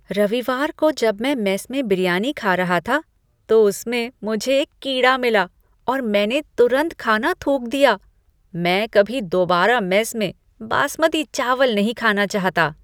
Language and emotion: Hindi, disgusted